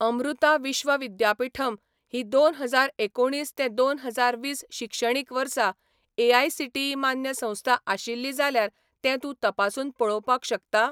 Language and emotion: Goan Konkani, neutral